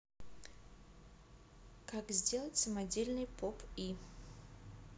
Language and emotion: Russian, neutral